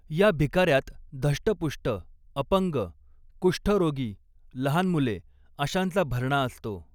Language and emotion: Marathi, neutral